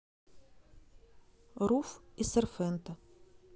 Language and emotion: Russian, neutral